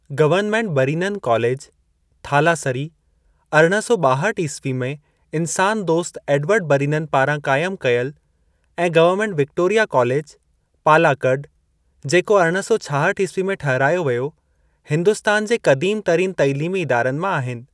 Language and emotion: Sindhi, neutral